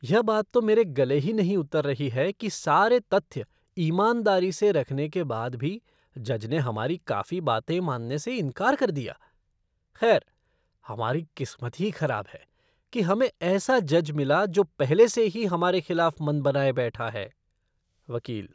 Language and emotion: Hindi, disgusted